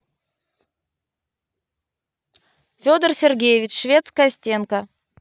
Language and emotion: Russian, positive